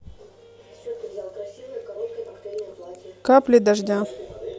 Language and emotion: Russian, neutral